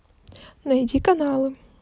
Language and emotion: Russian, neutral